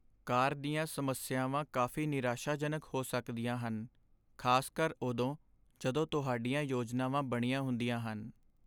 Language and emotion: Punjabi, sad